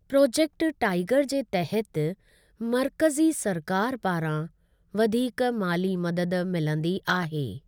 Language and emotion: Sindhi, neutral